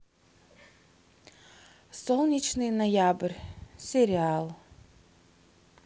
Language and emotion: Russian, neutral